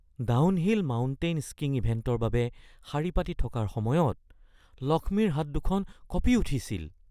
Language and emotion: Assamese, fearful